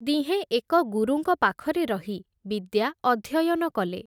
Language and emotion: Odia, neutral